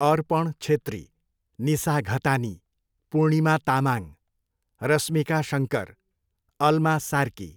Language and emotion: Nepali, neutral